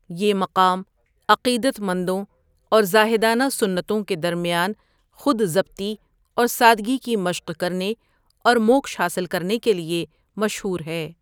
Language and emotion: Urdu, neutral